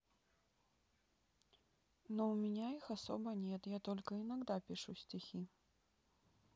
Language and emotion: Russian, sad